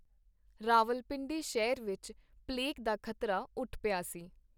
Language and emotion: Punjabi, neutral